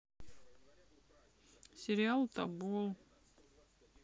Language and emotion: Russian, sad